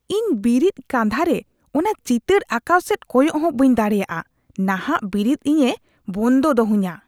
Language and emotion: Santali, disgusted